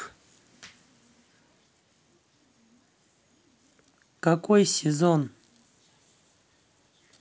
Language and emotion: Russian, neutral